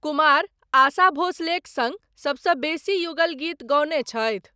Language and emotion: Maithili, neutral